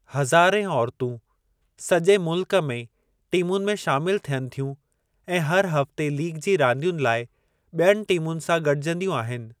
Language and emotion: Sindhi, neutral